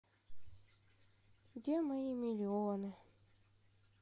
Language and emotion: Russian, sad